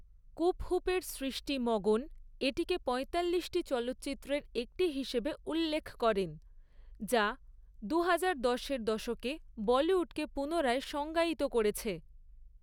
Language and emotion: Bengali, neutral